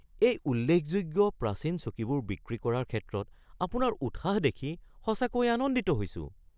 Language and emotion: Assamese, surprised